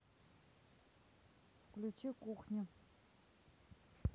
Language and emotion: Russian, neutral